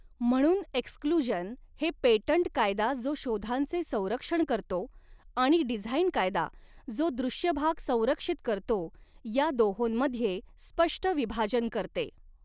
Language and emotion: Marathi, neutral